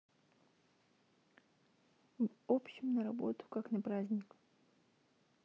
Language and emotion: Russian, neutral